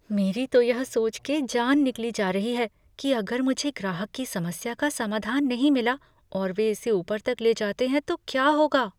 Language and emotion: Hindi, fearful